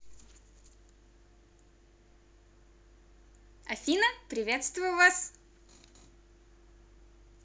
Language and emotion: Russian, positive